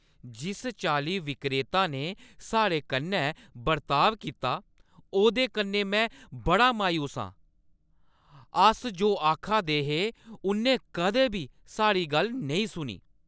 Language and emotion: Dogri, angry